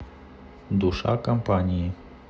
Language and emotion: Russian, neutral